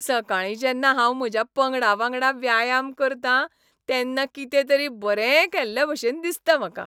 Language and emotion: Goan Konkani, happy